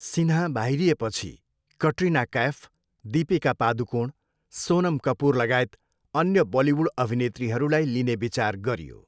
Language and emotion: Nepali, neutral